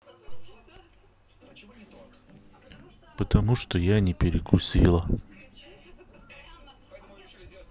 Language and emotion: Russian, neutral